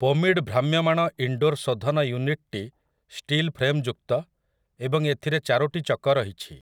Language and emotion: Odia, neutral